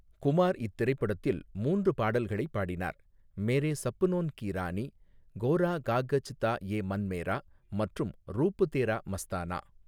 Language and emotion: Tamil, neutral